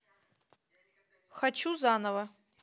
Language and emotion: Russian, neutral